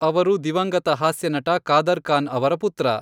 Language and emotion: Kannada, neutral